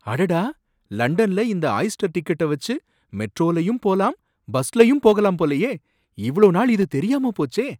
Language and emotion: Tamil, surprised